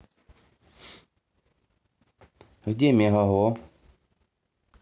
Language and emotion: Russian, neutral